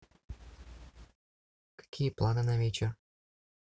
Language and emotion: Russian, neutral